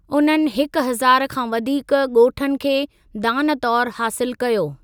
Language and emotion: Sindhi, neutral